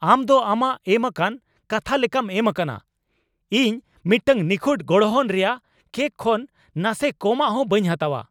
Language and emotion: Santali, angry